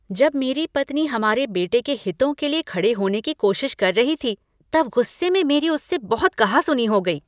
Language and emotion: Hindi, angry